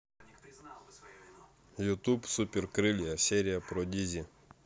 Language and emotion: Russian, neutral